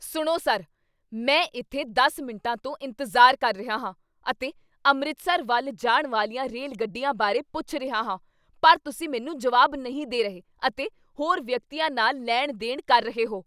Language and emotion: Punjabi, angry